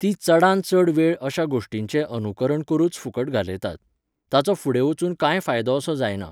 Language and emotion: Goan Konkani, neutral